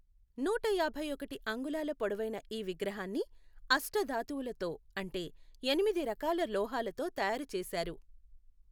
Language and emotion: Telugu, neutral